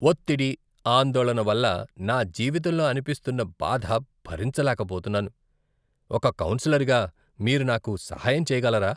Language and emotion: Telugu, disgusted